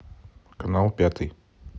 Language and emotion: Russian, neutral